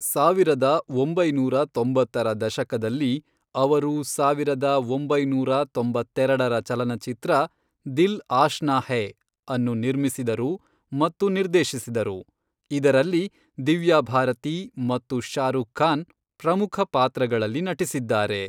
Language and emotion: Kannada, neutral